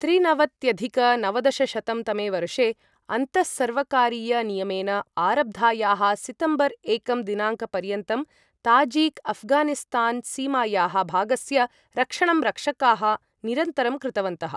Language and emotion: Sanskrit, neutral